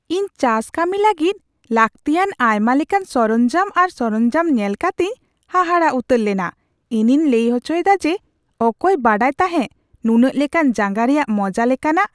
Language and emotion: Santali, surprised